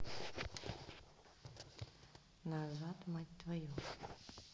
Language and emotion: Russian, neutral